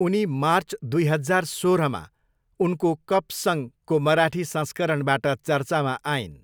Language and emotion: Nepali, neutral